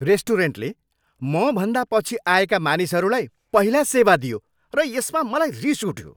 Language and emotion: Nepali, angry